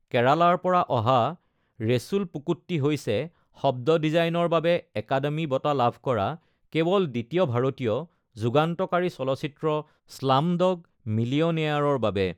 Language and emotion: Assamese, neutral